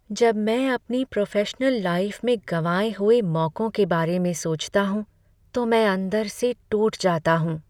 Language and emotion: Hindi, sad